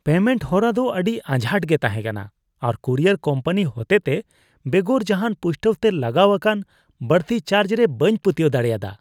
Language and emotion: Santali, disgusted